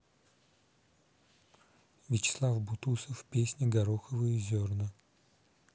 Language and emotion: Russian, neutral